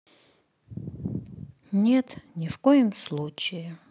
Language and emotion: Russian, sad